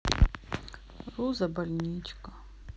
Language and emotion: Russian, sad